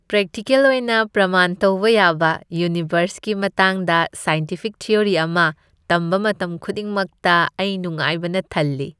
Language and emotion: Manipuri, happy